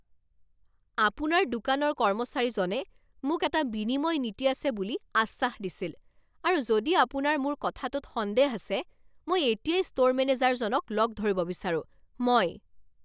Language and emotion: Assamese, angry